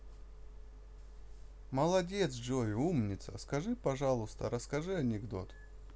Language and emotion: Russian, positive